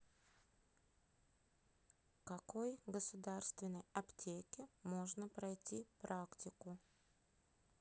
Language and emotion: Russian, neutral